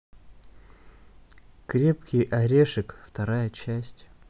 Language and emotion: Russian, neutral